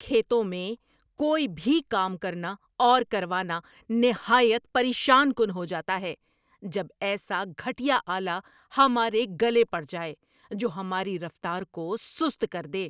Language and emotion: Urdu, angry